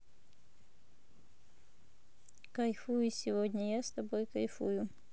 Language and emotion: Russian, neutral